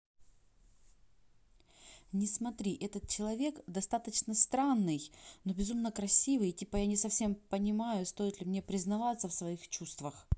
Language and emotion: Russian, neutral